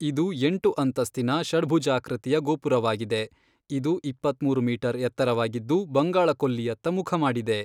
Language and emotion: Kannada, neutral